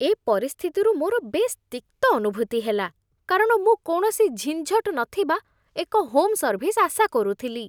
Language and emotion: Odia, disgusted